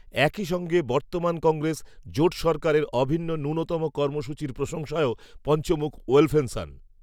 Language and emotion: Bengali, neutral